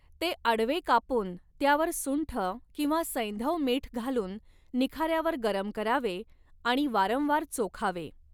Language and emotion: Marathi, neutral